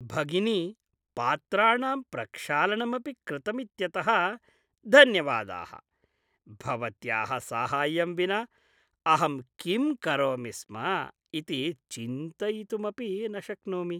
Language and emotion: Sanskrit, happy